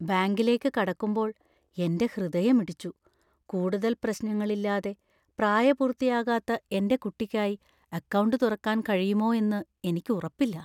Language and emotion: Malayalam, fearful